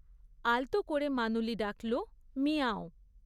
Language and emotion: Bengali, neutral